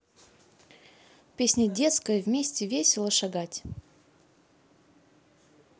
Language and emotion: Russian, neutral